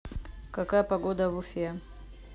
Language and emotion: Russian, neutral